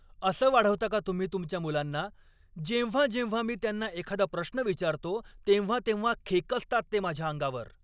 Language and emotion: Marathi, angry